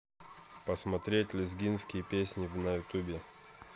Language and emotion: Russian, neutral